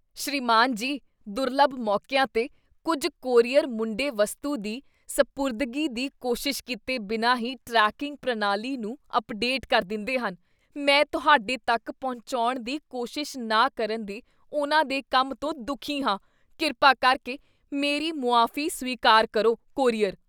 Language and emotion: Punjabi, disgusted